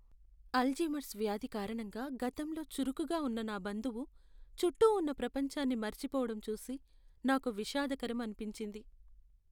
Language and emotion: Telugu, sad